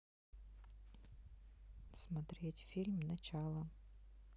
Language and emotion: Russian, neutral